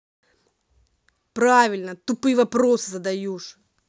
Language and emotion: Russian, angry